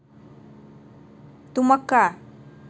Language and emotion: Russian, neutral